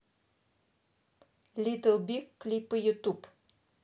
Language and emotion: Russian, neutral